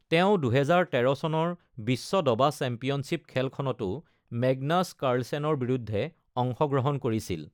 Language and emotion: Assamese, neutral